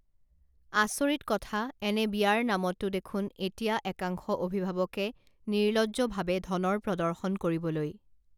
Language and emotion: Assamese, neutral